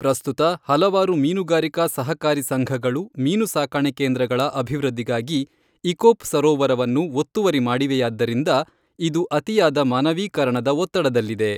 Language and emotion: Kannada, neutral